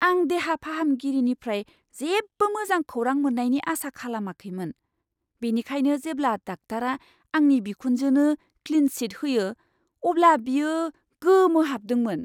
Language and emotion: Bodo, surprised